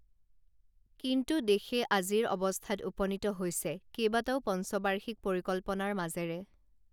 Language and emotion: Assamese, neutral